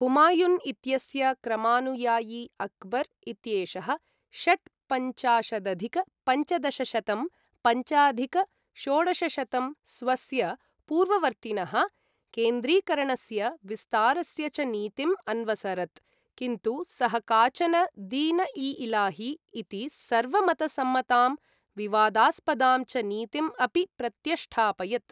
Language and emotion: Sanskrit, neutral